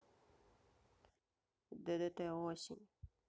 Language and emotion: Russian, neutral